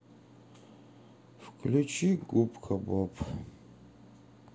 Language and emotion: Russian, sad